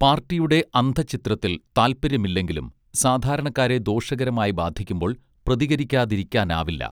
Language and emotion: Malayalam, neutral